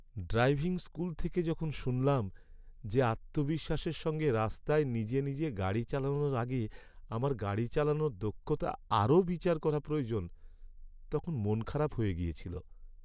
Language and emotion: Bengali, sad